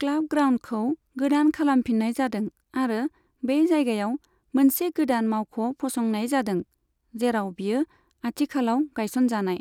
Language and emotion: Bodo, neutral